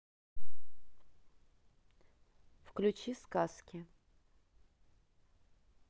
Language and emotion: Russian, neutral